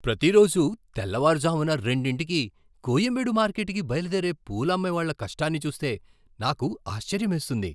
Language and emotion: Telugu, surprised